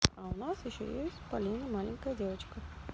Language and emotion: Russian, neutral